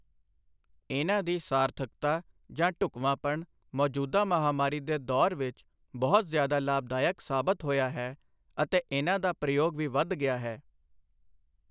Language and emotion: Punjabi, neutral